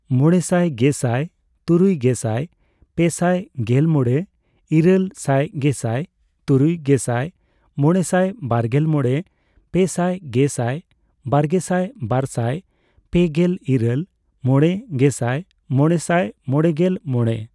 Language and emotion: Santali, neutral